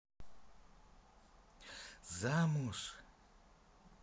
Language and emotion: Russian, positive